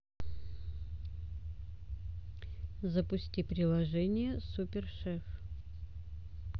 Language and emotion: Russian, neutral